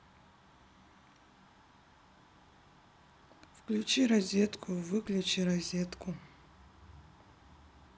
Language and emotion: Russian, sad